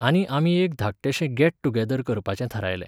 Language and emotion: Goan Konkani, neutral